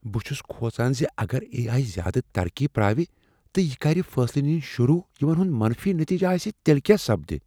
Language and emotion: Kashmiri, fearful